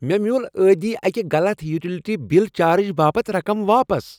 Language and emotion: Kashmiri, happy